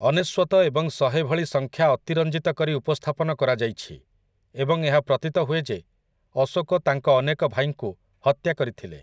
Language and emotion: Odia, neutral